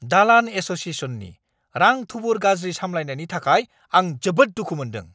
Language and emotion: Bodo, angry